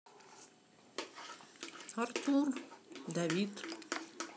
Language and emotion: Russian, neutral